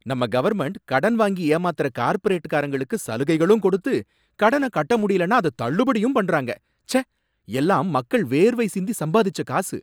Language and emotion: Tamil, angry